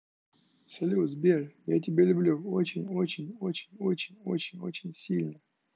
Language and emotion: Russian, neutral